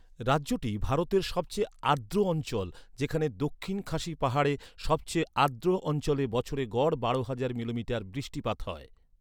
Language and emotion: Bengali, neutral